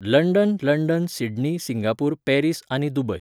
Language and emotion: Goan Konkani, neutral